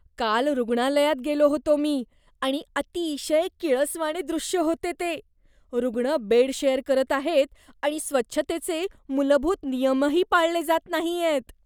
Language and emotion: Marathi, disgusted